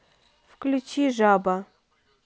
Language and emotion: Russian, neutral